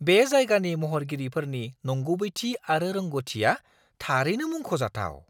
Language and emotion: Bodo, surprised